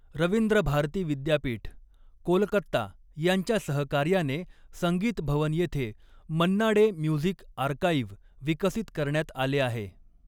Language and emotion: Marathi, neutral